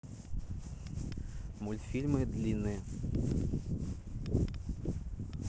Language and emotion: Russian, neutral